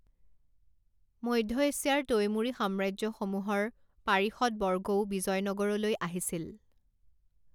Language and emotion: Assamese, neutral